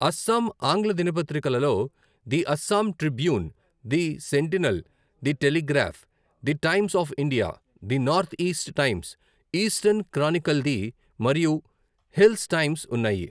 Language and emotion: Telugu, neutral